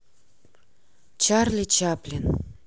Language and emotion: Russian, neutral